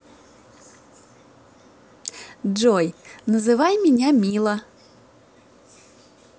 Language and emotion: Russian, positive